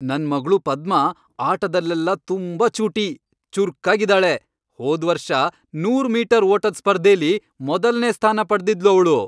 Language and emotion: Kannada, happy